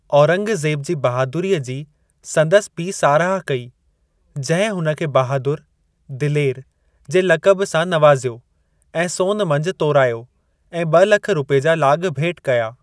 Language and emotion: Sindhi, neutral